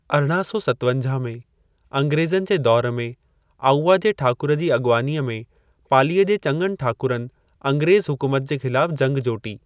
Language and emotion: Sindhi, neutral